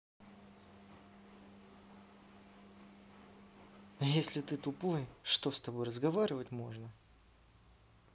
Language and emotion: Russian, neutral